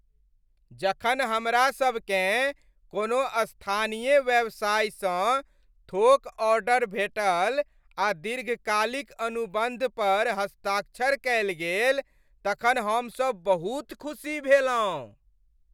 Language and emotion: Maithili, happy